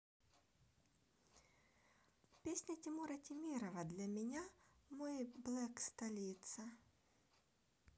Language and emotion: Russian, neutral